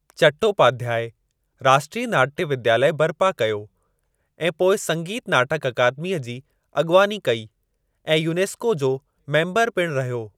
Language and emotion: Sindhi, neutral